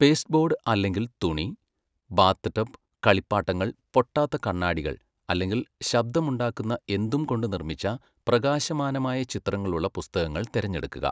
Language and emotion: Malayalam, neutral